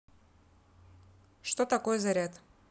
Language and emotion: Russian, neutral